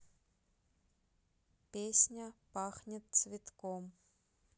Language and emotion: Russian, neutral